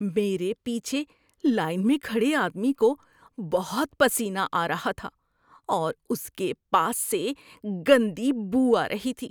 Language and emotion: Urdu, disgusted